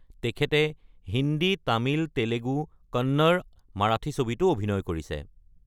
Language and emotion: Assamese, neutral